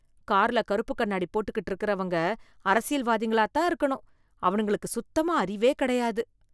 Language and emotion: Tamil, disgusted